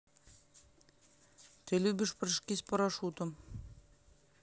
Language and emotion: Russian, neutral